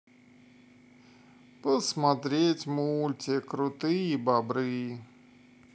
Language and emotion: Russian, sad